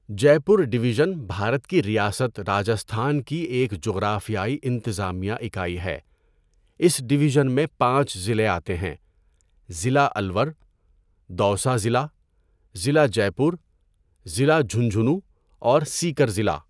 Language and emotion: Urdu, neutral